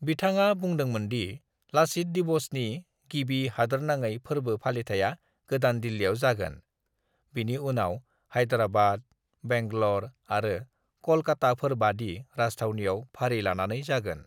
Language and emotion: Bodo, neutral